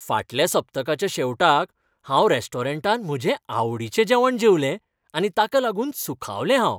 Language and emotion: Goan Konkani, happy